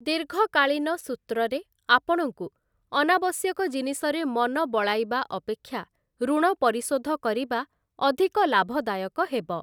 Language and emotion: Odia, neutral